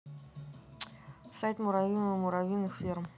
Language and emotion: Russian, neutral